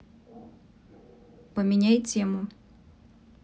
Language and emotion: Russian, neutral